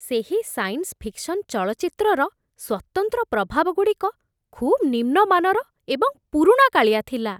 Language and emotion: Odia, disgusted